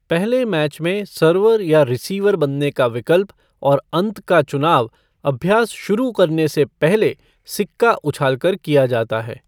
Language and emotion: Hindi, neutral